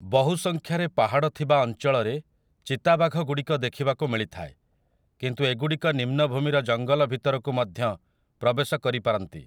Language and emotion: Odia, neutral